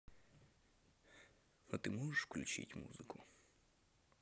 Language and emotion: Russian, neutral